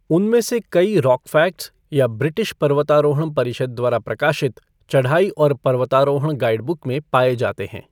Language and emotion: Hindi, neutral